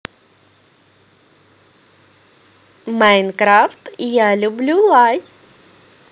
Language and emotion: Russian, positive